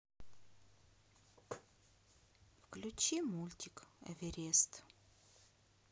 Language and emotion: Russian, sad